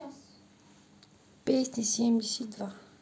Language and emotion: Russian, neutral